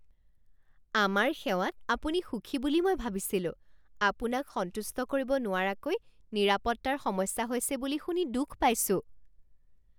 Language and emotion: Assamese, surprised